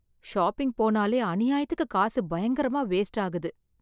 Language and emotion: Tamil, sad